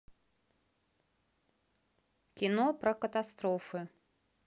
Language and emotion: Russian, neutral